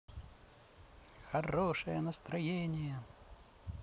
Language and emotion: Russian, positive